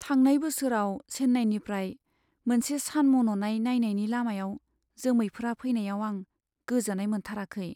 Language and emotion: Bodo, sad